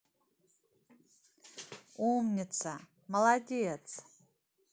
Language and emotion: Russian, positive